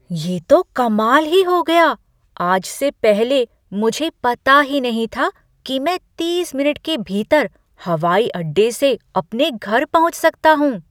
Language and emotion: Hindi, surprised